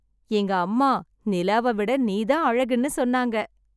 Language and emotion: Tamil, happy